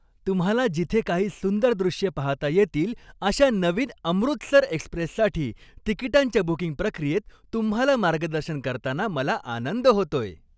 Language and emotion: Marathi, happy